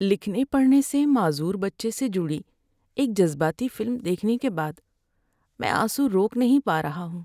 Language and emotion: Urdu, sad